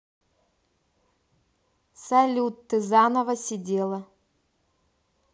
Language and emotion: Russian, neutral